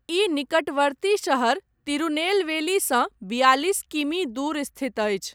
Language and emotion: Maithili, neutral